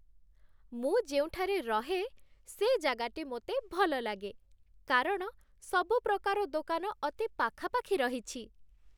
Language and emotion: Odia, happy